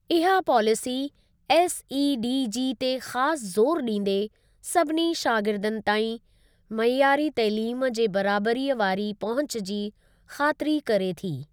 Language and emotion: Sindhi, neutral